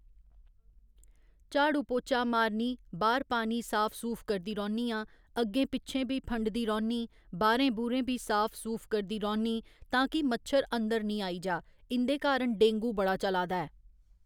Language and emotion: Dogri, neutral